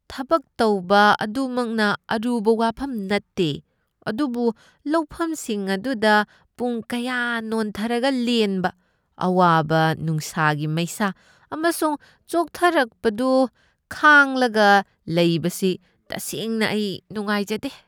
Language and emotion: Manipuri, disgusted